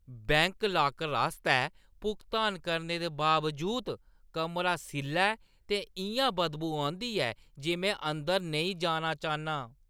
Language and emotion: Dogri, disgusted